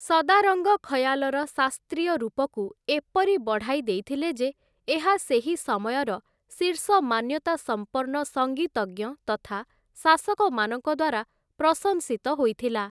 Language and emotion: Odia, neutral